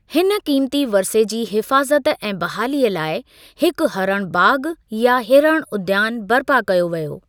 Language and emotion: Sindhi, neutral